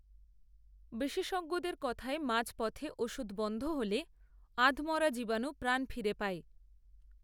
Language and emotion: Bengali, neutral